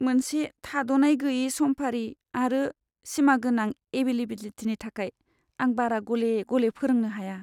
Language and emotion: Bodo, sad